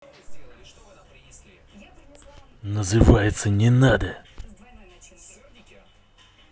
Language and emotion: Russian, angry